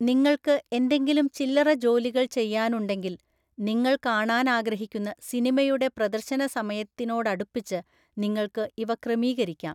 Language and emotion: Malayalam, neutral